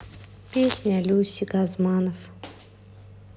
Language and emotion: Russian, sad